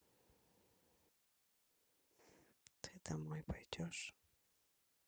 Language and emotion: Russian, neutral